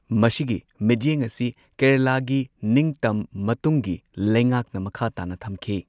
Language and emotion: Manipuri, neutral